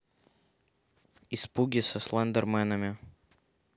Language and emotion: Russian, neutral